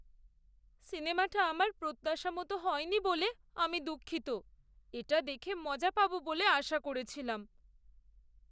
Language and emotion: Bengali, sad